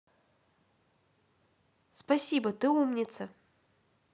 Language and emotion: Russian, positive